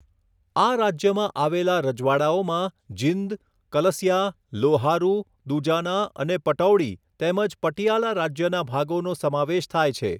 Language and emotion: Gujarati, neutral